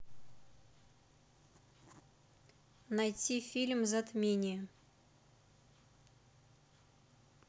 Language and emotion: Russian, neutral